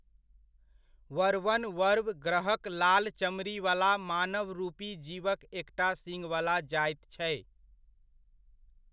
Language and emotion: Maithili, neutral